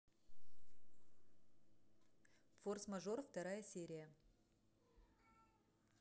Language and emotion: Russian, neutral